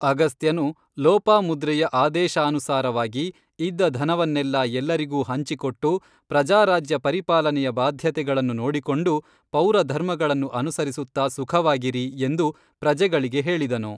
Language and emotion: Kannada, neutral